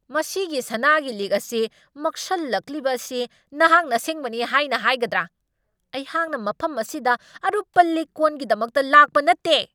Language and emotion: Manipuri, angry